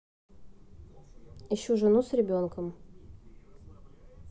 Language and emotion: Russian, neutral